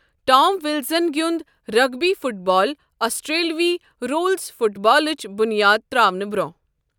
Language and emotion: Kashmiri, neutral